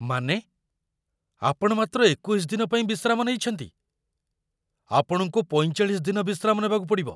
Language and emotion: Odia, surprised